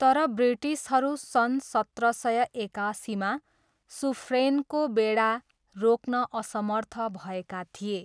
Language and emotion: Nepali, neutral